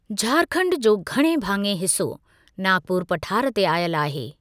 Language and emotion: Sindhi, neutral